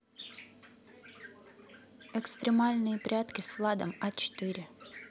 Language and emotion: Russian, neutral